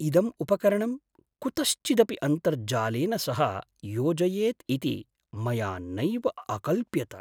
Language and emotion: Sanskrit, surprised